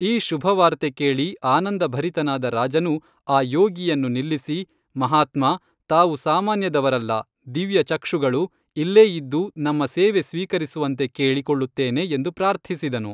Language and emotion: Kannada, neutral